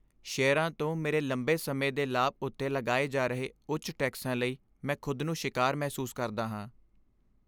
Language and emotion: Punjabi, sad